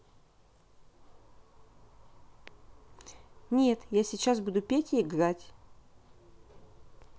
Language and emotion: Russian, neutral